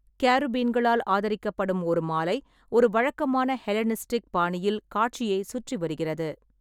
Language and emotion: Tamil, neutral